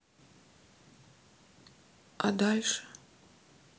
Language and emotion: Russian, sad